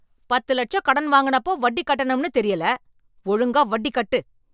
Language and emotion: Tamil, angry